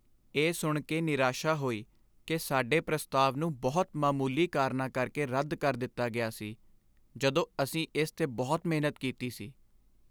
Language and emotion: Punjabi, sad